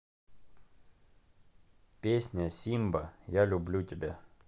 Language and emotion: Russian, neutral